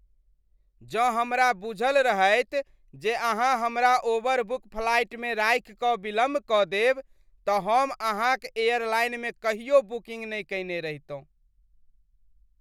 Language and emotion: Maithili, disgusted